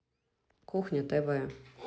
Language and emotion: Russian, neutral